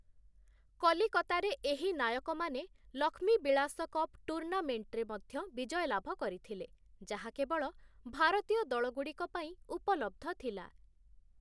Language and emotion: Odia, neutral